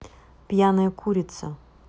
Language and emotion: Russian, neutral